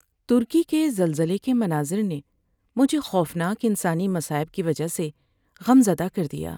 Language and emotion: Urdu, sad